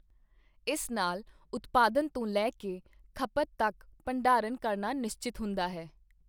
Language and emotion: Punjabi, neutral